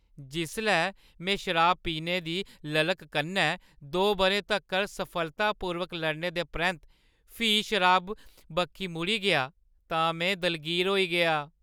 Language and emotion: Dogri, sad